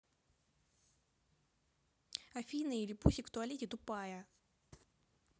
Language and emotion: Russian, angry